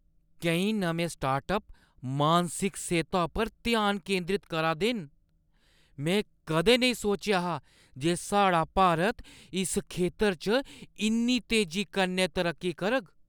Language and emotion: Dogri, surprised